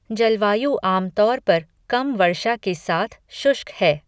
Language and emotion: Hindi, neutral